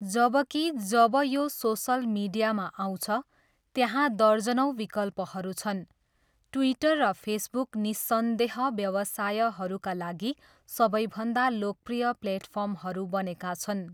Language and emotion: Nepali, neutral